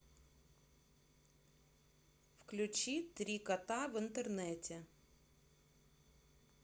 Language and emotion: Russian, neutral